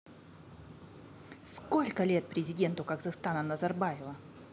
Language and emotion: Russian, angry